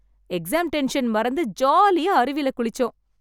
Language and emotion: Tamil, happy